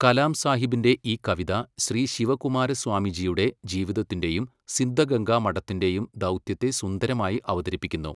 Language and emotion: Malayalam, neutral